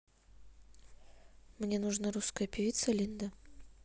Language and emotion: Russian, neutral